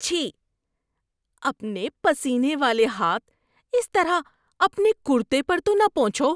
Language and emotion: Urdu, disgusted